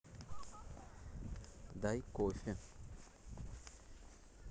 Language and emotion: Russian, neutral